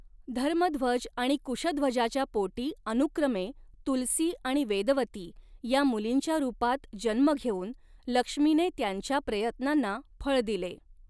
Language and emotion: Marathi, neutral